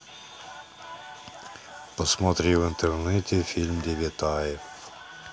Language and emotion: Russian, neutral